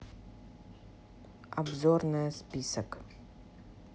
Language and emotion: Russian, neutral